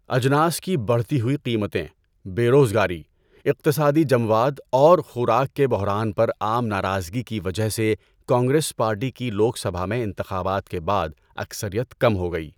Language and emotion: Urdu, neutral